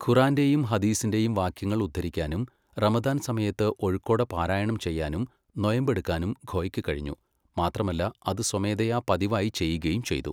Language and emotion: Malayalam, neutral